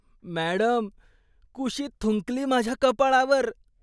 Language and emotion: Marathi, disgusted